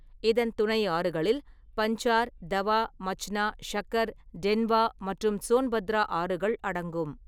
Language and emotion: Tamil, neutral